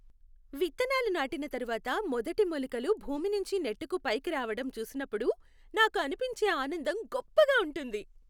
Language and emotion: Telugu, happy